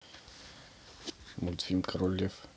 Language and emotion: Russian, neutral